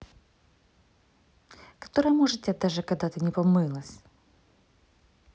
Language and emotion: Russian, neutral